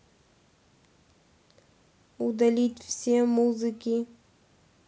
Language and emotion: Russian, neutral